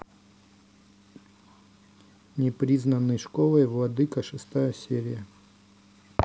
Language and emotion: Russian, neutral